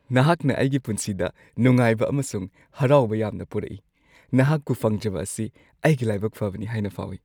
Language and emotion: Manipuri, happy